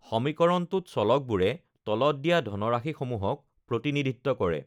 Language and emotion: Assamese, neutral